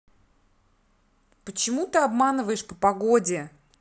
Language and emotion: Russian, angry